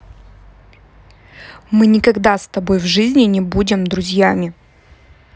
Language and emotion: Russian, angry